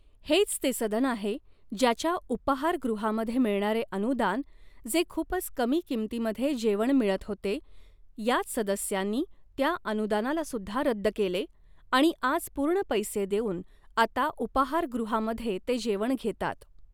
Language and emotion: Marathi, neutral